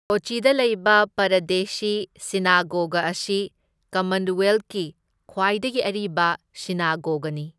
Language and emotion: Manipuri, neutral